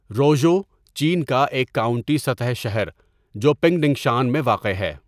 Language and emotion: Urdu, neutral